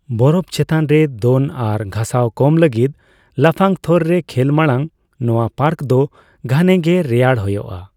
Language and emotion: Santali, neutral